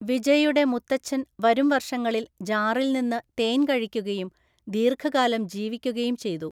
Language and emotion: Malayalam, neutral